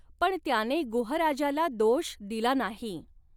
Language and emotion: Marathi, neutral